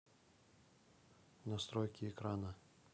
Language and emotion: Russian, neutral